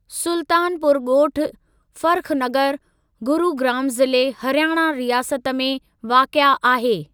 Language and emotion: Sindhi, neutral